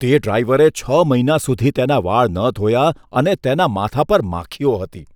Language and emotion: Gujarati, disgusted